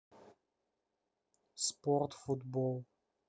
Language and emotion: Russian, neutral